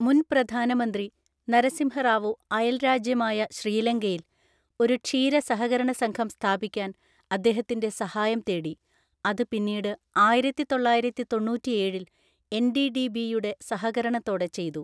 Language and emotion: Malayalam, neutral